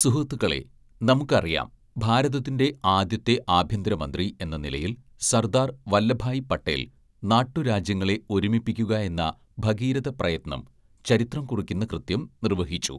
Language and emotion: Malayalam, neutral